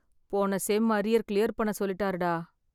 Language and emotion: Tamil, sad